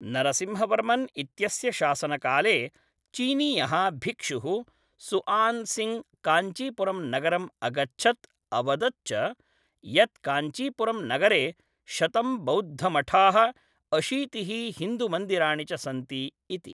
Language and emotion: Sanskrit, neutral